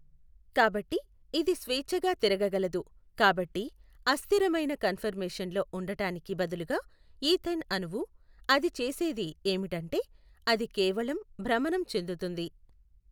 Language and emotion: Telugu, neutral